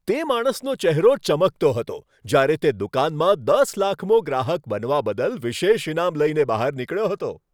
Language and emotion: Gujarati, happy